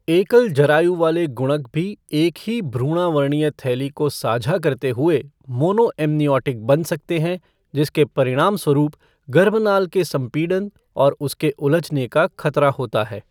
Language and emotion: Hindi, neutral